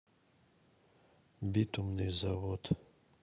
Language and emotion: Russian, neutral